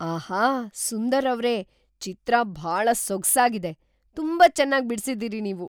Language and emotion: Kannada, surprised